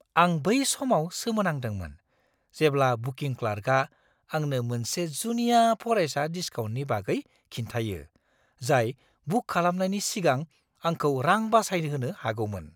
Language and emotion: Bodo, surprised